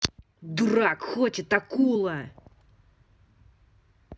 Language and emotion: Russian, angry